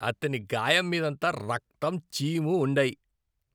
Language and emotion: Telugu, disgusted